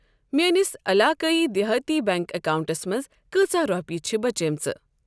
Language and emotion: Kashmiri, neutral